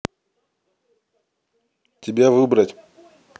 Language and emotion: Russian, neutral